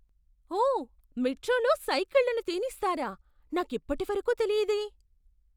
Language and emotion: Telugu, surprised